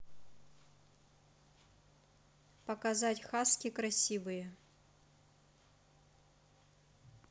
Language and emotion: Russian, neutral